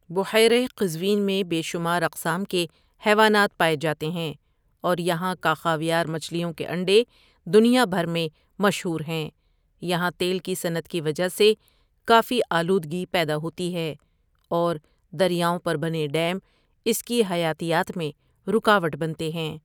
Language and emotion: Urdu, neutral